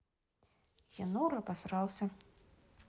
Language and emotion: Russian, neutral